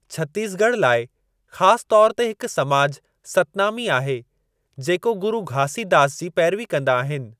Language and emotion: Sindhi, neutral